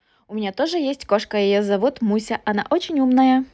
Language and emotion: Russian, positive